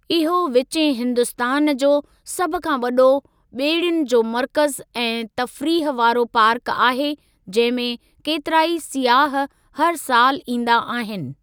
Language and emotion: Sindhi, neutral